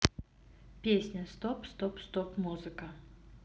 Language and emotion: Russian, neutral